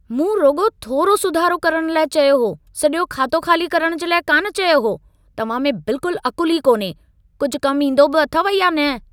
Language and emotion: Sindhi, angry